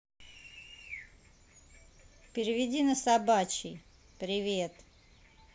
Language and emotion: Russian, neutral